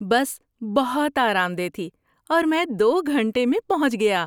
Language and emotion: Urdu, happy